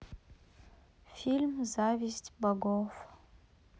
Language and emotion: Russian, sad